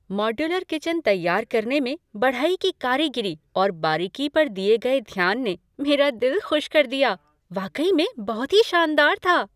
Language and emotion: Hindi, happy